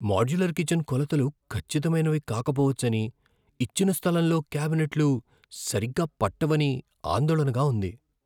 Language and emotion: Telugu, fearful